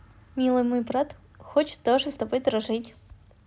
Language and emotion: Russian, positive